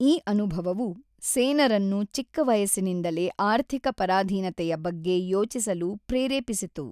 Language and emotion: Kannada, neutral